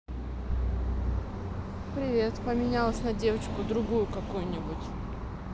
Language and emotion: Russian, neutral